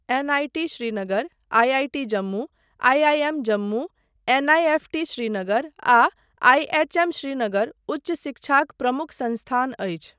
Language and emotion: Maithili, neutral